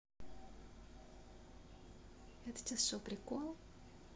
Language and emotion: Russian, neutral